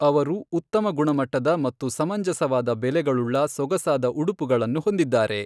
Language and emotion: Kannada, neutral